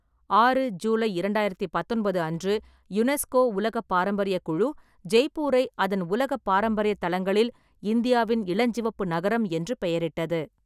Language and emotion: Tamil, neutral